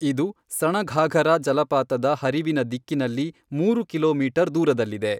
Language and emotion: Kannada, neutral